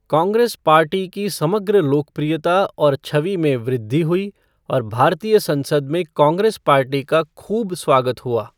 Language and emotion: Hindi, neutral